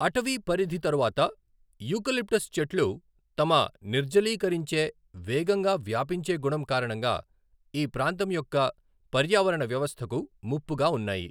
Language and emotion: Telugu, neutral